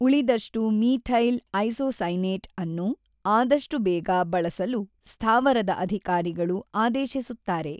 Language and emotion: Kannada, neutral